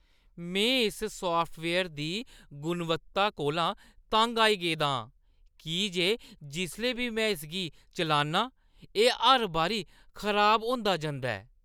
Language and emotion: Dogri, disgusted